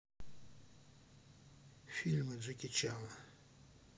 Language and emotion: Russian, neutral